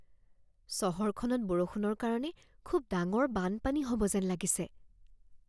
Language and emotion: Assamese, fearful